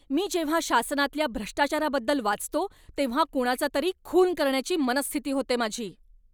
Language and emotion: Marathi, angry